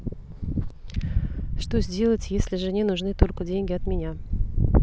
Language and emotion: Russian, neutral